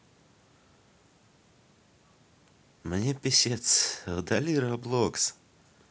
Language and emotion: Russian, neutral